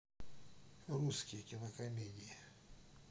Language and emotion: Russian, neutral